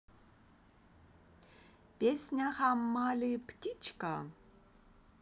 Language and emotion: Russian, positive